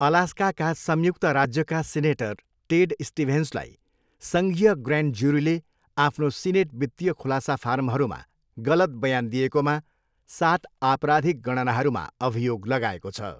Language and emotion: Nepali, neutral